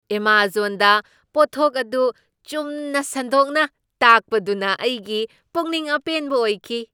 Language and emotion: Manipuri, surprised